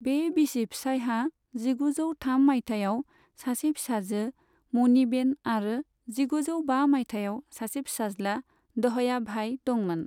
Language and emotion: Bodo, neutral